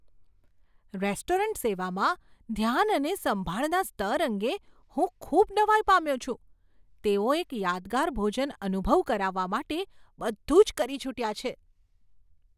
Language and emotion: Gujarati, surprised